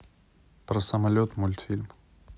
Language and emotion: Russian, neutral